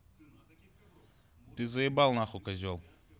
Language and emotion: Russian, angry